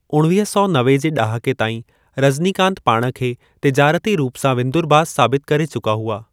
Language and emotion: Sindhi, neutral